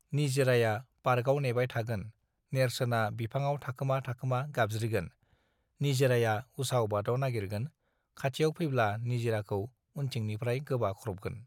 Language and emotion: Bodo, neutral